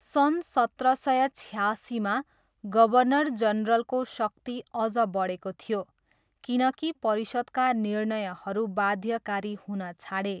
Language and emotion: Nepali, neutral